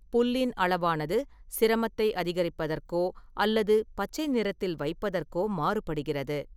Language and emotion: Tamil, neutral